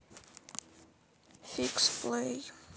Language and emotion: Russian, sad